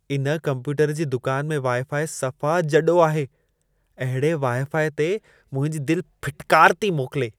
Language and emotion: Sindhi, disgusted